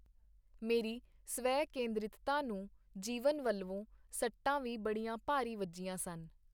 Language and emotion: Punjabi, neutral